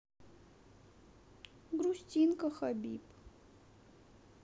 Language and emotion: Russian, sad